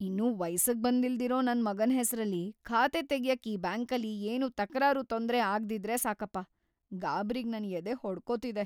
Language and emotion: Kannada, fearful